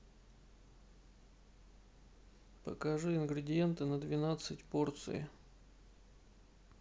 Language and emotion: Russian, neutral